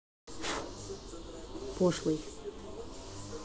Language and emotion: Russian, neutral